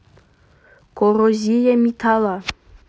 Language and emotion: Russian, neutral